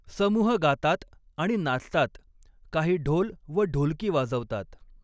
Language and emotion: Marathi, neutral